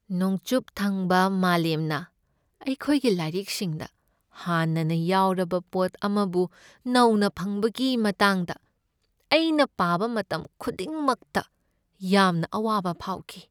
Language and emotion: Manipuri, sad